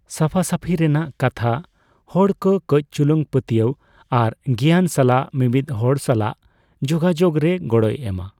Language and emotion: Santali, neutral